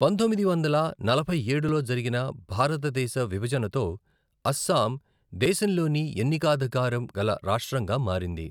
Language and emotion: Telugu, neutral